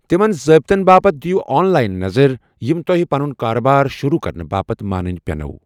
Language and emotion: Kashmiri, neutral